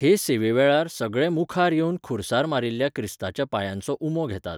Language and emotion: Goan Konkani, neutral